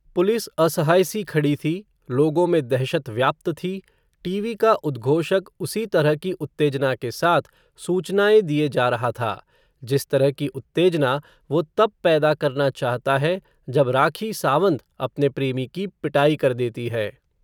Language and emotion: Hindi, neutral